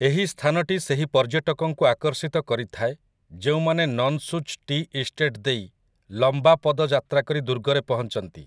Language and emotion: Odia, neutral